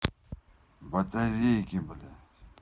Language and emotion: Russian, angry